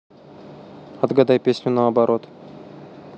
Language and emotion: Russian, neutral